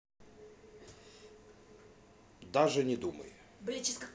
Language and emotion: Russian, neutral